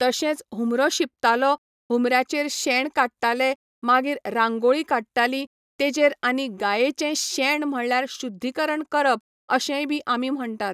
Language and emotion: Goan Konkani, neutral